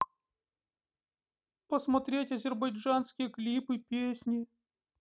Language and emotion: Russian, sad